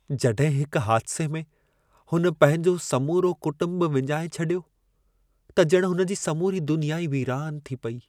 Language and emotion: Sindhi, sad